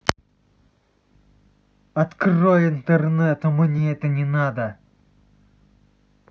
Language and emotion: Russian, angry